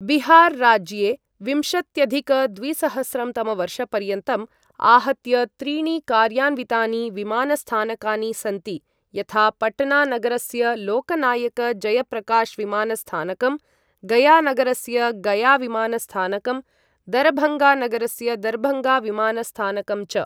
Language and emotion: Sanskrit, neutral